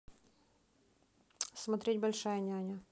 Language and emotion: Russian, neutral